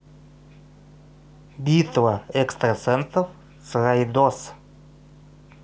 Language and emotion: Russian, neutral